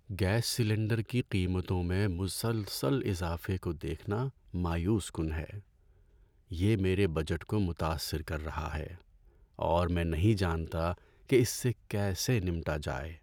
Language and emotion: Urdu, sad